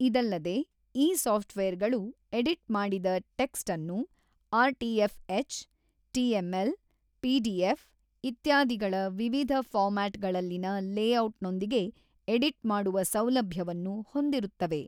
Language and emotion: Kannada, neutral